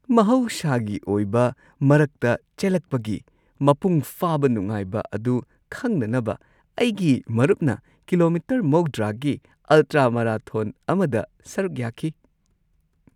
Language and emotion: Manipuri, happy